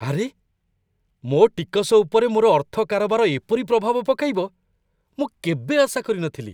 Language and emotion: Odia, surprised